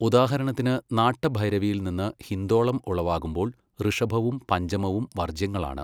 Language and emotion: Malayalam, neutral